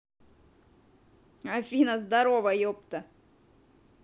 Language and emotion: Russian, positive